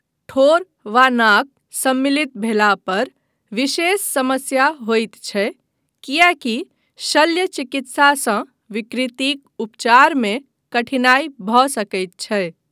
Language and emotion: Maithili, neutral